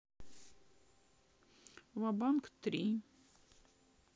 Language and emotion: Russian, sad